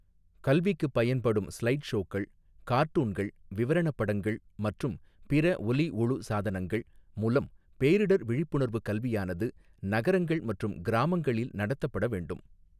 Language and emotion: Tamil, neutral